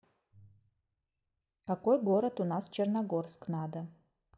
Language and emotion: Russian, neutral